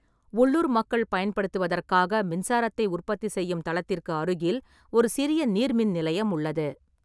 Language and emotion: Tamil, neutral